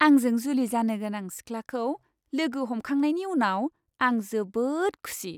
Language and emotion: Bodo, happy